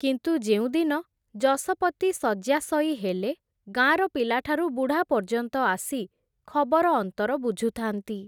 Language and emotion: Odia, neutral